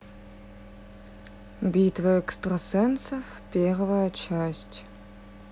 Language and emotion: Russian, neutral